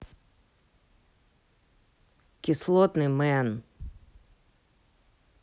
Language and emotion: Russian, angry